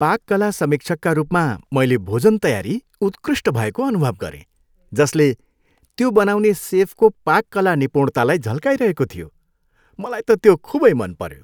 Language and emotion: Nepali, happy